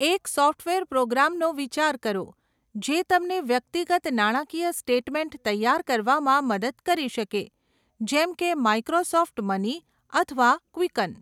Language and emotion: Gujarati, neutral